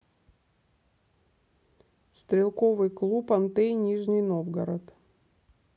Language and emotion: Russian, neutral